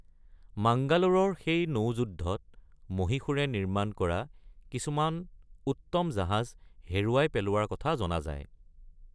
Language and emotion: Assamese, neutral